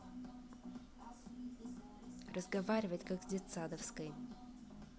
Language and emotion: Russian, angry